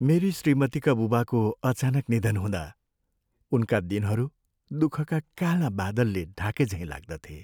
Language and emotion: Nepali, sad